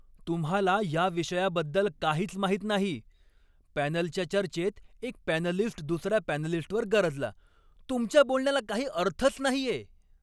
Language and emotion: Marathi, angry